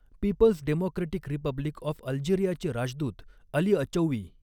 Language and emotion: Marathi, neutral